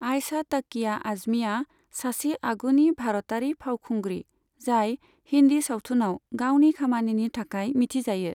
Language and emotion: Bodo, neutral